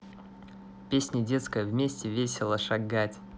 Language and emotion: Russian, positive